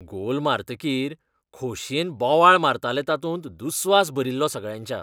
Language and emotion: Goan Konkani, disgusted